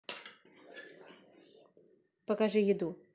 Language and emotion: Russian, neutral